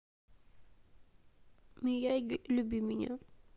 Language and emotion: Russian, sad